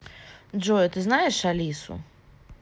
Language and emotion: Russian, neutral